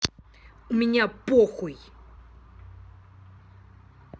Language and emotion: Russian, angry